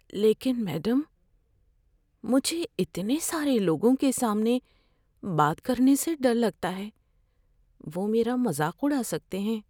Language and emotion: Urdu, fearful